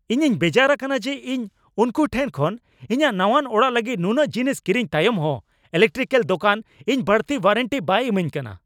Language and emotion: Santali, angry